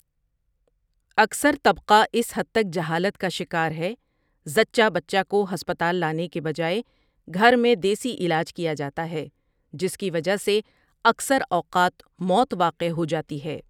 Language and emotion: Urdu, neutral